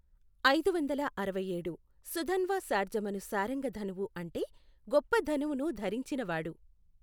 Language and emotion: Telugu, neutral